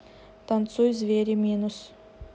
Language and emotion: Russian, neutral